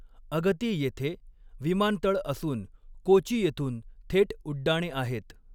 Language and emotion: Marathi, neutral